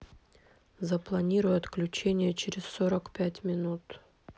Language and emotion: Russian, neutral